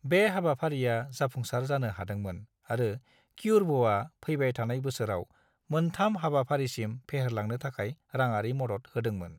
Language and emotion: Bodo, neutral